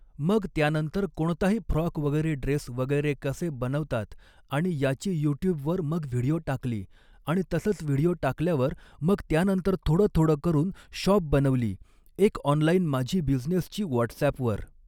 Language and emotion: Marathi, neutral